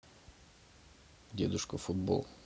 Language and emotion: Russian, neutral